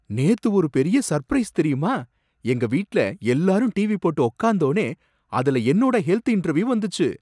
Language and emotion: Tamil, surprised